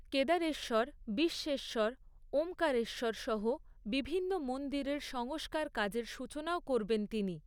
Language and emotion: Bengali, neutral